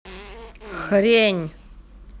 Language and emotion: Russian, angry